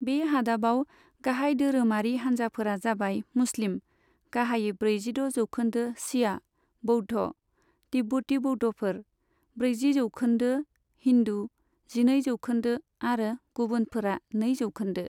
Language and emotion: Bodo, neutral